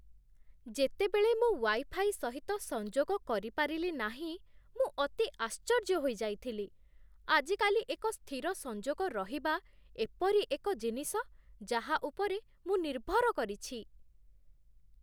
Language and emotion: Odia, surprised